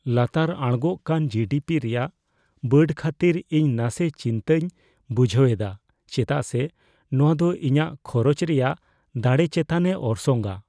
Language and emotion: Santali, fearful